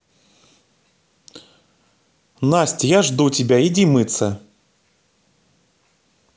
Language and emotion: Russian, positive